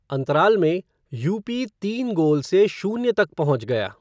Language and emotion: Hindi, neutral